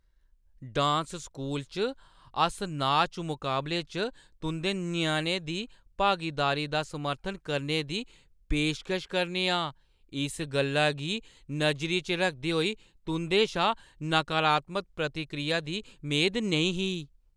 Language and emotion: Dogri, surprised